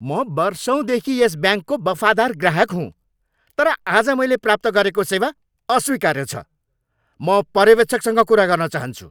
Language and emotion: Nepali, angry